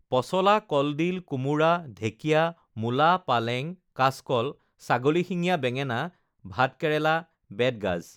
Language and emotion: Assamese, neutral